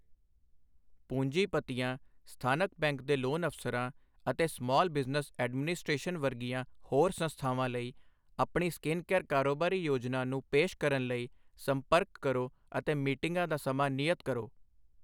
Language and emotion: Punjabi, neutral